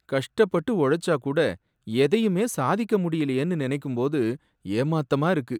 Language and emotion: Tamil, sad